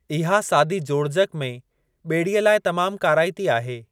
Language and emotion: Sindhi, neutral